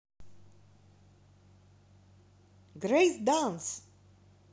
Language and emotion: Russian, positive